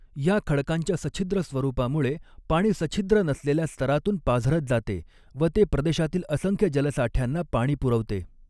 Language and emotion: Marathi, neutral